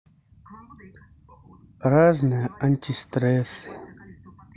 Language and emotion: Russian, neutral